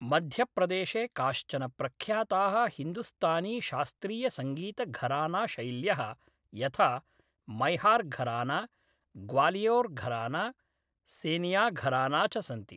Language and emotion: Sanskrit, neutral